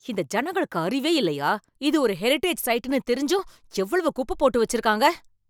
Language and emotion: Tamil, angry